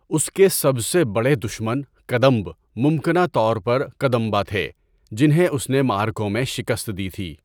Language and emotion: Urdu, neutral